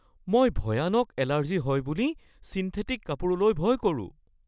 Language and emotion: Assamese, fearful